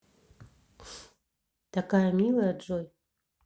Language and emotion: Russian, neutral